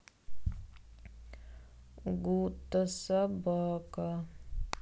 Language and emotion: Russian, sad